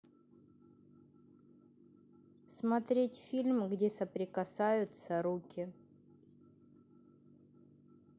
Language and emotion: Russian, neutral